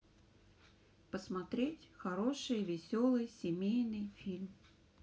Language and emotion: Russian, neutral